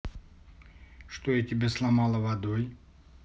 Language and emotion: Russian, neutral